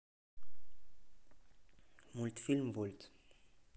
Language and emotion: Russian, neutral